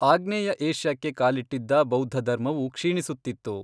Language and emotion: Kannada, neutral